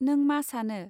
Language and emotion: Bodo, neutral